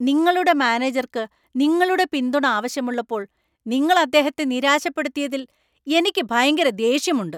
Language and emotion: Malayalam, angry